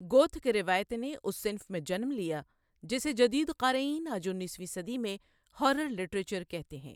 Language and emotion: Urdu, neutral